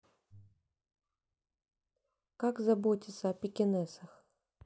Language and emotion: Russian, neutral